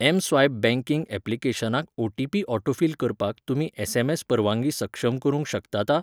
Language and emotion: Goan Konkani, neutral